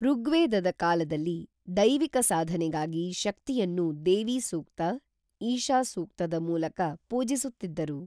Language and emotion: Kannada, neutral